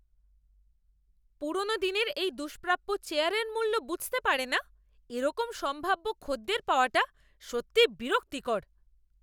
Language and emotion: Bengali, angry